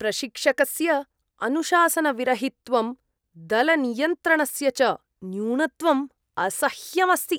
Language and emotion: Sanskrit, disgusted